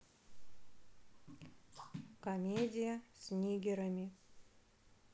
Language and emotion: Russian, neutral